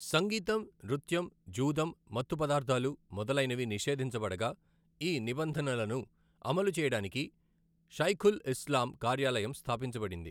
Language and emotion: Telugu, neutral